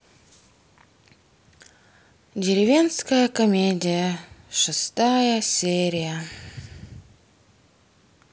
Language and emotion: Russian, sad